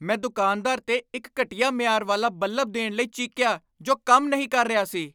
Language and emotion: Punjabi, angry